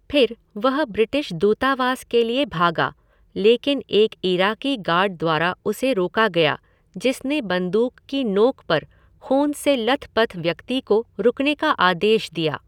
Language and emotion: Hindi, neutral